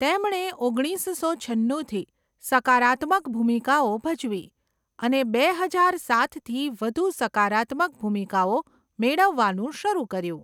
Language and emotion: Gujarati, neutral